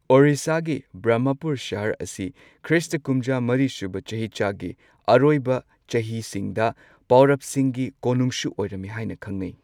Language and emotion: Manipuri, neutral